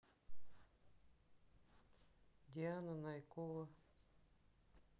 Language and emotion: Russian, neutral